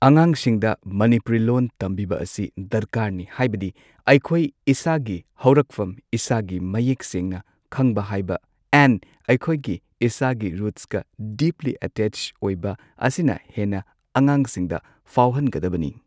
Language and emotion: Manipuri, neutral